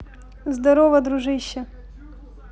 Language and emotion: Russian, positive